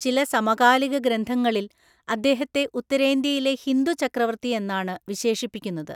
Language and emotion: Malayalam, neutral